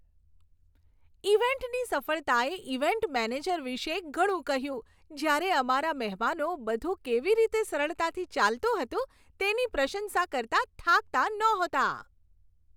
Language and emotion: Gujarati, happy